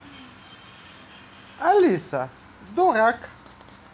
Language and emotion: Russian, positive